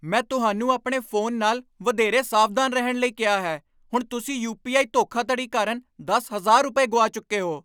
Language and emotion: Punjabi, angry